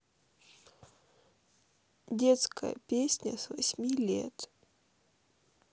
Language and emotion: Russian, sad